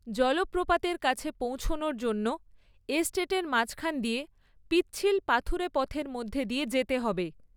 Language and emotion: Bengali, neutral